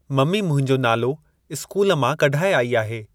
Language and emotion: Sindhi, neutral